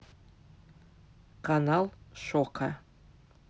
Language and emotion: Russian, neutral